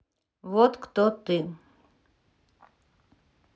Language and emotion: Russian, neutral